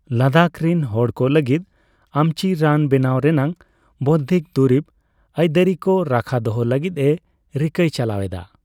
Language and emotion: Santali, neutral